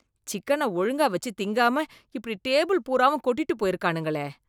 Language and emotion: Tamil, disgusted